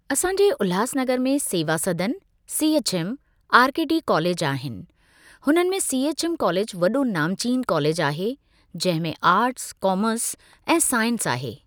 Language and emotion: Sindhi, neutral